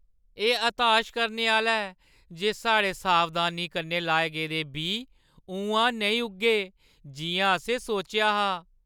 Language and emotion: Dogri, sad